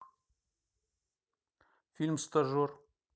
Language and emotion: Russian, neutral